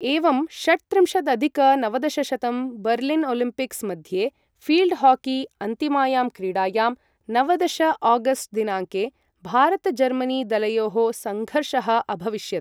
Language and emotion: Sanskrit, neutral